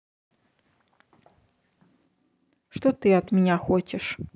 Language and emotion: Russian, neutral